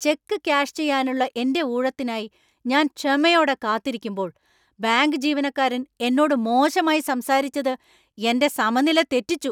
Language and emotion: Malayalam, angry